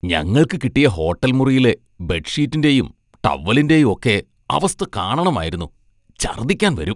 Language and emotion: Malayalam, disgusted